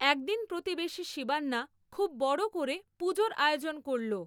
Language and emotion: Bengali, neutral